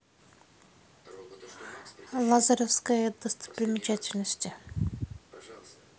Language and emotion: Russian, neutral